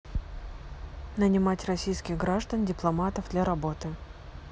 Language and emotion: Russian, neutral